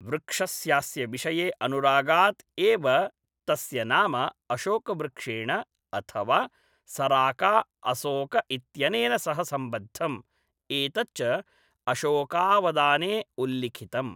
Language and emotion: Sanskrit, neutral